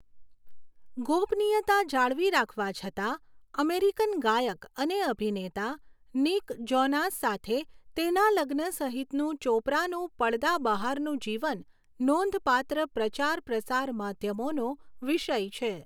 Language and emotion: Gujarati, neutral